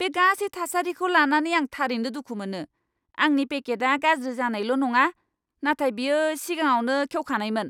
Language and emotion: Bodo, angry